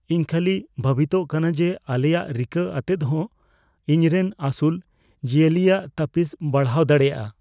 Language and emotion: Santali, fearful